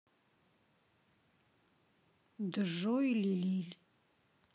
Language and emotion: Russian, neutral